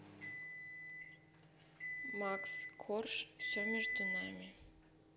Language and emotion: Russian, neutral